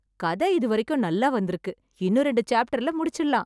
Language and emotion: Tamil, happy